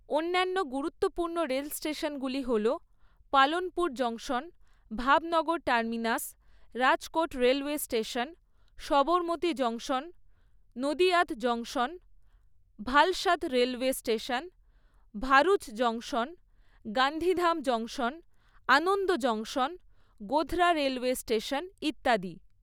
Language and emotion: Bengali, neutral